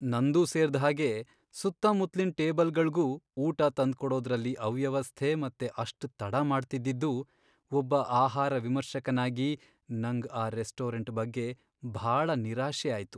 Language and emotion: Kannada, sad